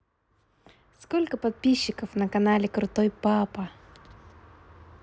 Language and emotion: Russian, positive